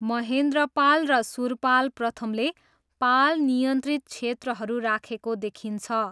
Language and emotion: Nepali, neutral